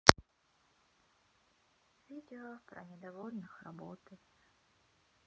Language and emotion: Russian, sad